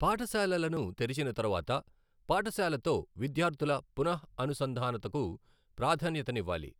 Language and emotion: Telugu, neutral